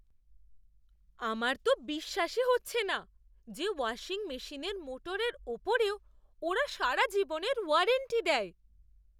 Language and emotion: Bengali, surprised